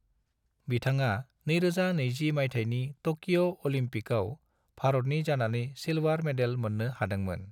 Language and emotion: Bodo, neutral